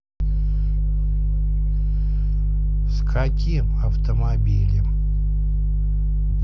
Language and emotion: Russian, neutral